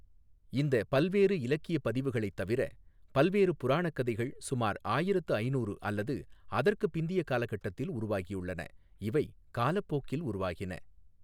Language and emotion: Tamil, neutral